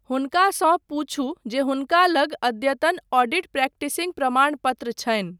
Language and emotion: Maithili, neutral